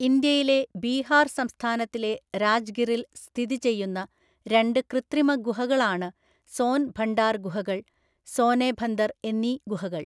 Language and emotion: Malayalam, neutral